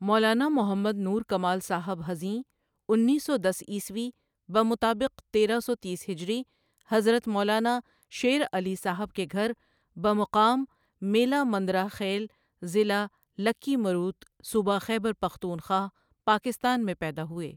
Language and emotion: Urdu, neutral